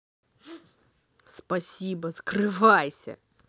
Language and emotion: Russian, angry